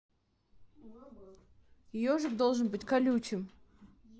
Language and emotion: Russian, neutral